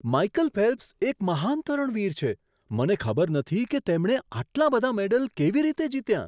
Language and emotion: Gujarati, surprised